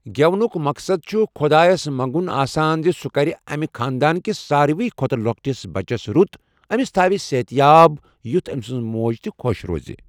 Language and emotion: Kashmiri, neutral